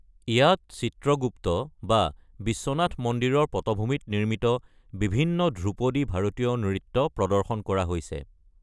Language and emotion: Assamese, neutral